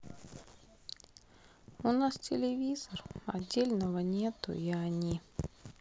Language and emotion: Russian, sad